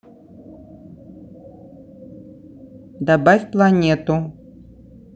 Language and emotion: Russian, neutral